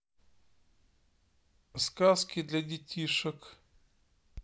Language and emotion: Russian, neutral